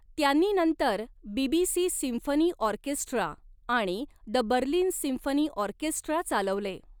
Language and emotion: Marathi, neutral